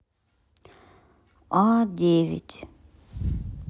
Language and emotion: Russian, neutral